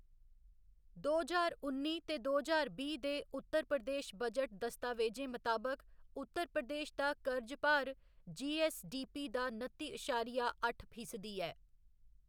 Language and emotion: Dogri, neutral